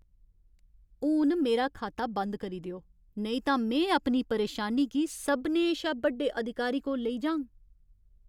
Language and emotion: Dogri, angry